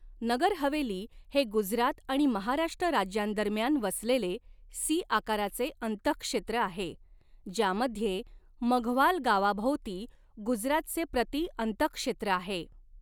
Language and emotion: Marathi, neutral